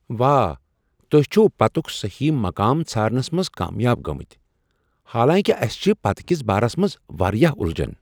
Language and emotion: Kashmiri, surprised